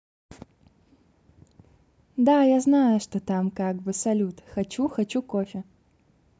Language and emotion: Russian, positive